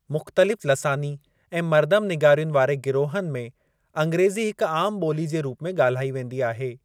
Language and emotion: Sindhi, neutral